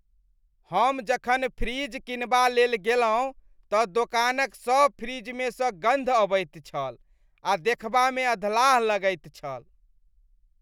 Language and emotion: Maithili, disgusted